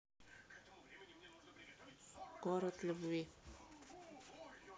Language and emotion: Russian, neutral